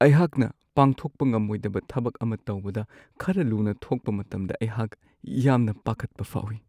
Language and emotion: Manipuri, sad